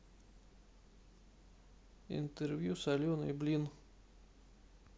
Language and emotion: Russian, neutral